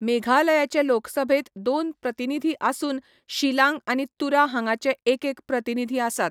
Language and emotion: Goan Konkani, neutral